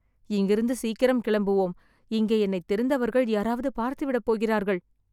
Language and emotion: Tamil, fearful